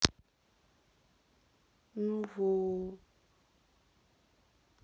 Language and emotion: Russian, sad